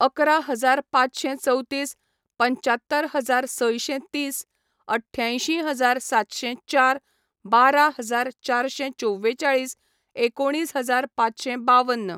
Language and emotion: Goan Konkani, neutral